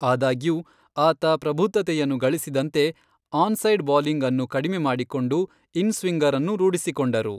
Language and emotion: Kannada, neutral